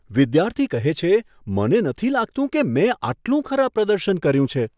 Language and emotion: Gujarati, surprised